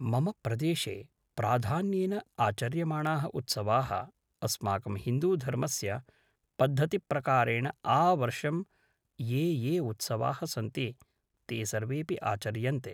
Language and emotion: Sanskrit, neutral